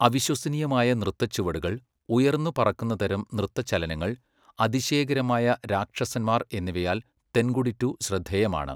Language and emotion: Malayalam, neutral